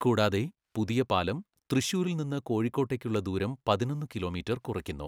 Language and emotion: Malayalam, neutral